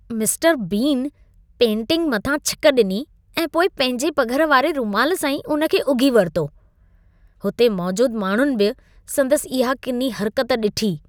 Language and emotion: Sindhi, disgusted